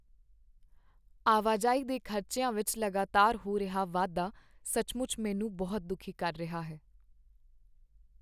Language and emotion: Punjabi, sad